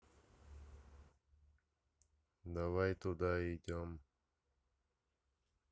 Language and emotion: Russian, neutral